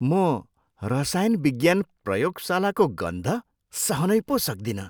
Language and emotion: Nepali, disgusted